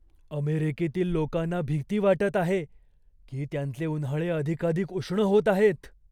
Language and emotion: Marathi, fearful